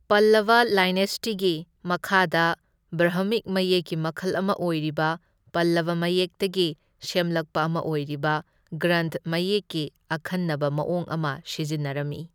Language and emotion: Manipuri, neutral